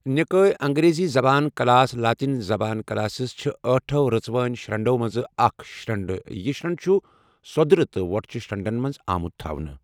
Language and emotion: Kashmiri, neutral